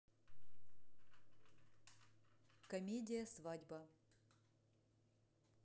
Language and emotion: Russian, neutral